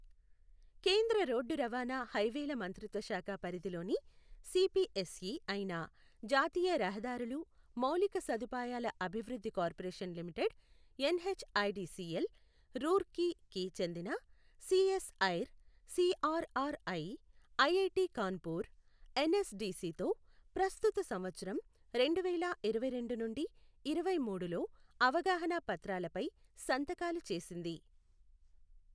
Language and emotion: Telugu, neutral